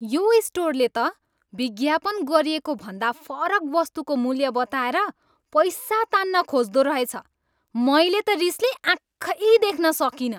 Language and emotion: Nepali, angry